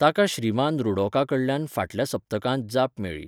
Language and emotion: Goan Konkani, neutral